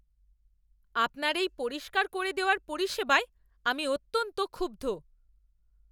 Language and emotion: Bengali, angry